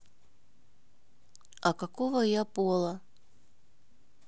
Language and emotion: Russian, neutral